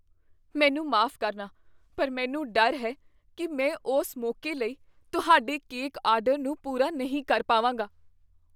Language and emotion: Punjabi, fearful